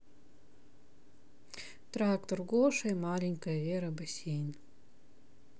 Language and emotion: Russian, sad